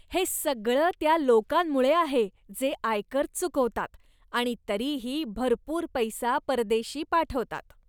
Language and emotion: Marathi, disgusted